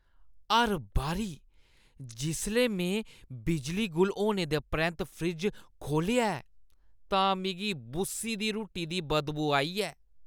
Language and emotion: Dogri, disgusted